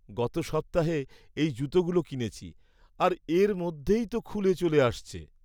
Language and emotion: Bengali, sad